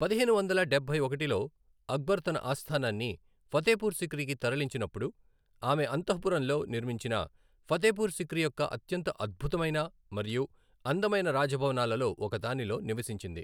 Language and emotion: Telugu, neutral